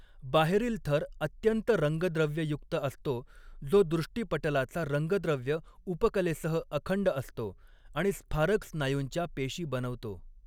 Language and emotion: Marathi, neutral